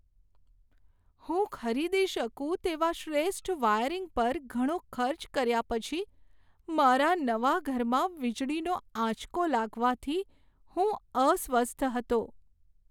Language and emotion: Gujarati, sad